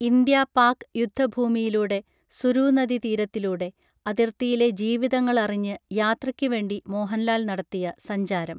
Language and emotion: Malayalam, neutral